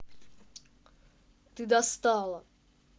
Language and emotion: Russian, angry